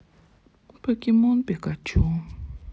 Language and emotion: Russian, sad